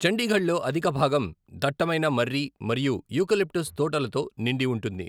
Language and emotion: Telugu, neutral